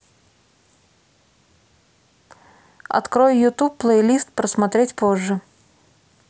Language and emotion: Russian, neutral